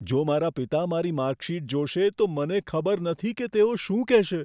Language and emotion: Gujarati, fearful